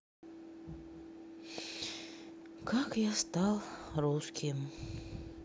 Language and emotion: Russian, sad